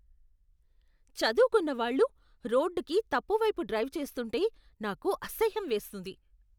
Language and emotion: Telugu, disgusted